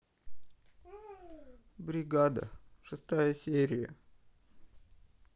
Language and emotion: Russian, sad